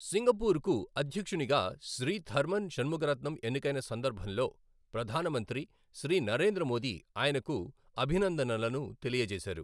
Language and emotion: Telugu, neutral